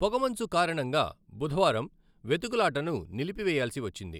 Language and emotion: Telugu, neutral